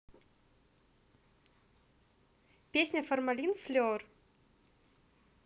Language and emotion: Russian, positive